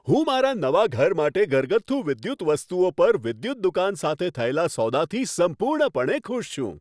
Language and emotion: Gujarati, happy